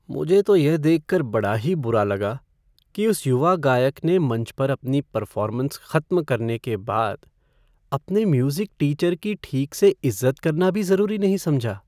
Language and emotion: Hindi, sad